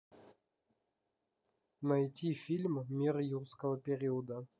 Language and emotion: Russian, neutral